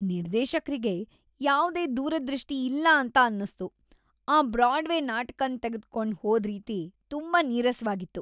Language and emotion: Kannada, disgusted